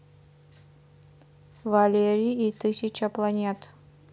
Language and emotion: Russian, neutral